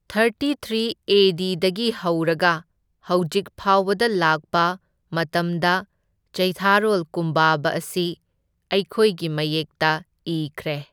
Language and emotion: Manipuri, neutral